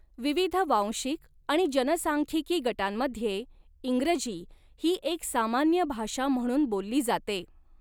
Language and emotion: Marathi, neutral